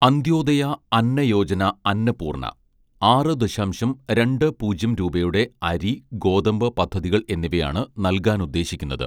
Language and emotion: Malayalam, neutral